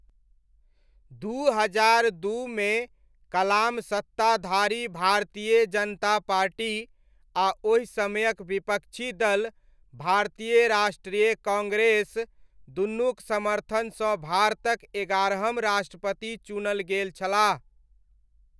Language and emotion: Maithili, neutral